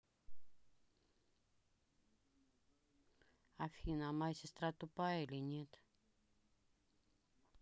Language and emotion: Russian, neutral